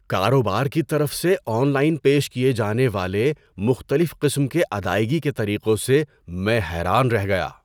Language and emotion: Urdu, surprised